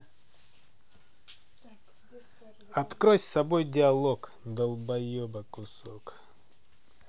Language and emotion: Russian, angry